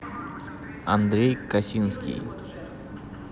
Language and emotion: Russian, neutral